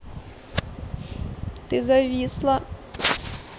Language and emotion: Russian, sad